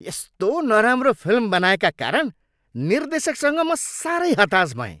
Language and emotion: Nepali, angry